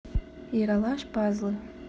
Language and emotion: Russian, neutral